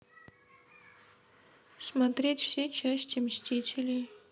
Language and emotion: Russian, sad